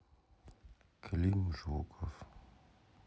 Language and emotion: Russian, sad